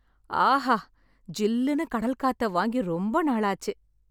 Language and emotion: Tamil, happy